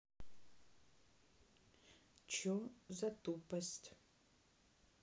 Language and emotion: Russian, neutral